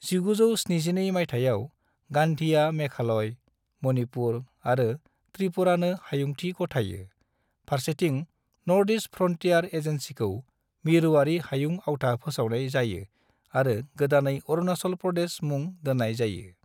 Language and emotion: Bodo, neutral